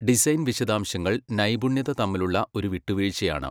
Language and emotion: Malayalam, neutral